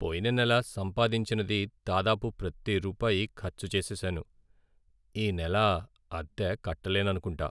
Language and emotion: Telugu, sad